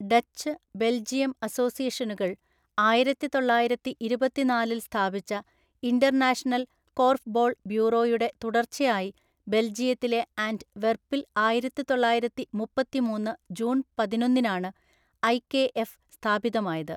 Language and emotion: Malayalam, neutral